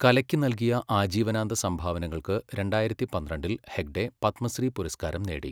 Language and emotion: Malayalam, neutral